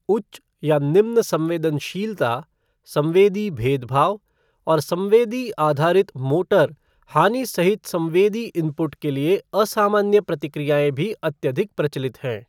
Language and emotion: Hindi, neutral